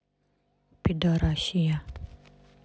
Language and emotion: Russian, neutral